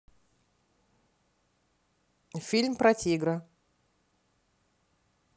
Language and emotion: Russian, neutral